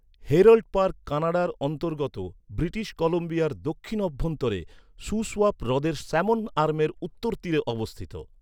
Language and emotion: Bengali, neutral